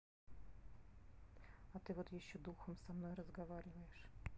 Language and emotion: Russian, neutral